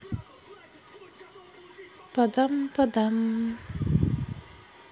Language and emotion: Russian, sad